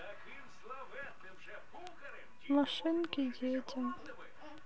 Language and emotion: Russian, sad